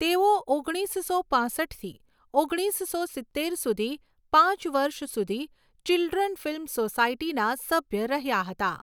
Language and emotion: Gujarati, neutral